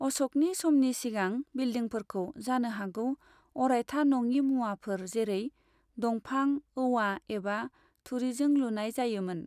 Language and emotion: Bodo, neutral